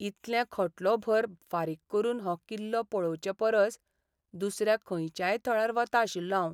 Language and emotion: Goan Konkani, sad